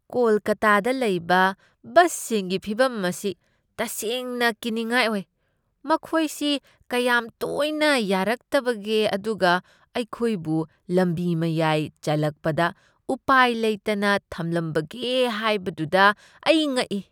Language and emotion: Manipuri, disgusted